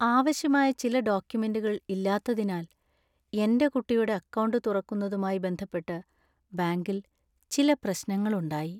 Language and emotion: Malayalam, sad